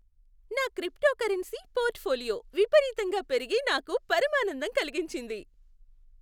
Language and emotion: Telugu, happy